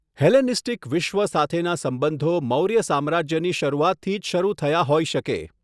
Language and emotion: Gujarati, neutral